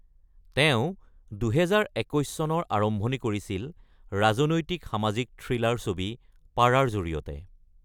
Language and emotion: Assamese, neutral